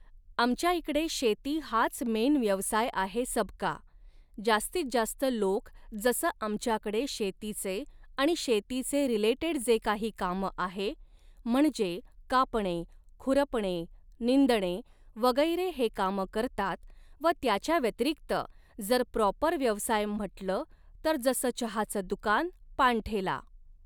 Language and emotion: Marathi, neutral